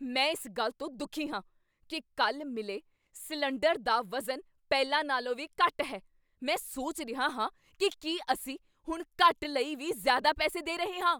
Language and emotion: Punjabi, angry